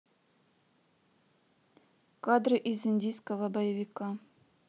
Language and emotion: Russian, neutral